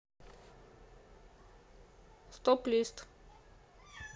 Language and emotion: Russian, neutral